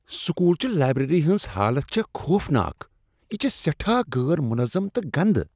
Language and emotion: Kashmiri, disgusted